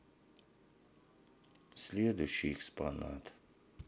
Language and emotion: Russian, sad